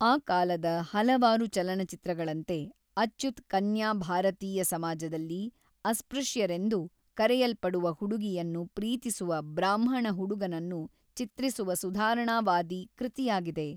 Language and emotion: Kannada, neutral